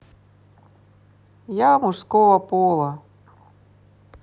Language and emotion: Russian, neutral